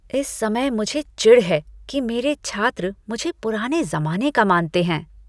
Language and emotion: Hindi, disgusted